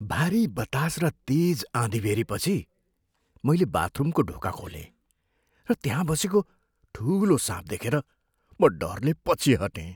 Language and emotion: Nepali, fearful